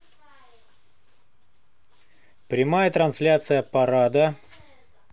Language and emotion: Russian, neutral